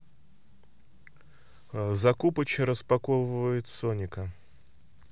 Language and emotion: Russian, neutral